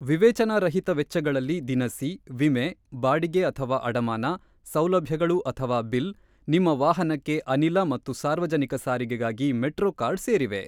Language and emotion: Kannada, neutral